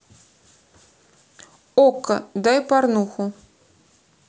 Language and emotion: Russian, neutral